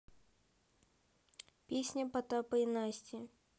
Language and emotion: Russian, neutral